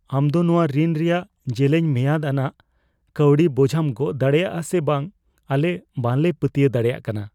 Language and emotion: Santali, fearful